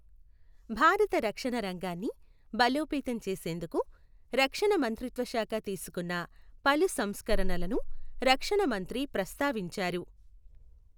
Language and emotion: Telugu, neutral